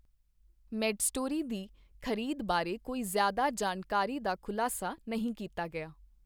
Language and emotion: Punjabi, neutral